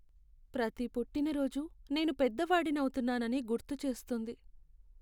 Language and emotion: Telugu, sad